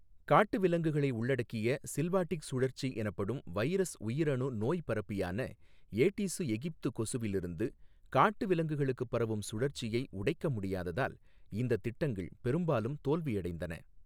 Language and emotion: Tamil, neutral